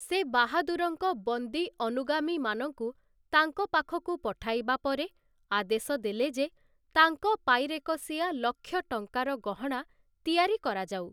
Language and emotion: Odia, neutral